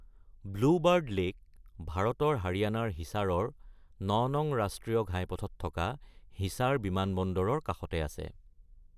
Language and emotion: Assamese, neutral